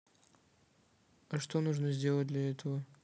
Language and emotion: Russian, neutral